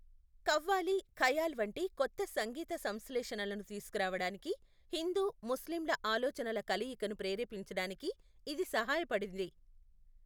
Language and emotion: Telugu, neutral